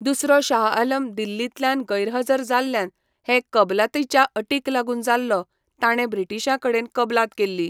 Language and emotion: Goan Konkani, neutral